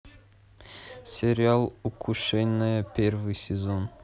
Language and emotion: Russian, neutral